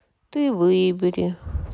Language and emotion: Russian, sad